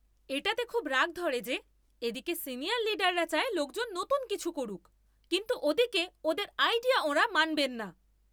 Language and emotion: Bengali, angry